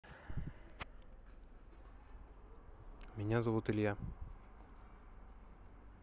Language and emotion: Russian, neutral